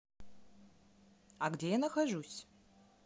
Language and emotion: Russian, neutral